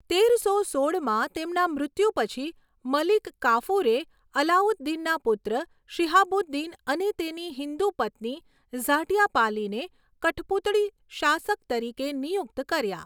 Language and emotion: Gujarati, neutral